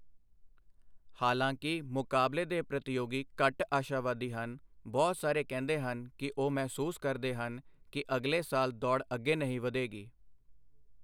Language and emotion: Punjabi, neutral